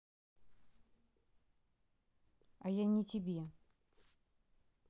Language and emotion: Russian, neutral